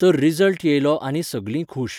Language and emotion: Goan Konkani, neutral